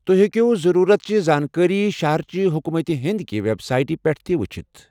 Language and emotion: Kashmiri, neutral